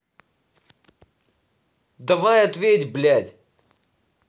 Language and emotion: Russian, angry